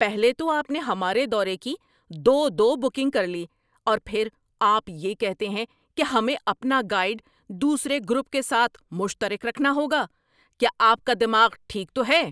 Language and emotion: Urdu, angry